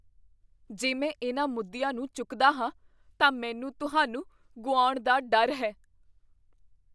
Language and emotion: Punjabi, fearful